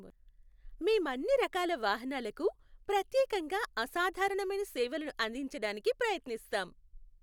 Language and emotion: Telugu, happy